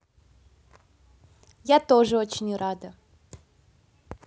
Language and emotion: Russian, positive